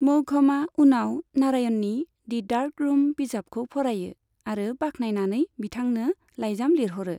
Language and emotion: Bodo, neutral